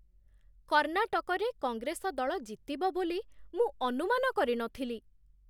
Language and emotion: Odia, surprised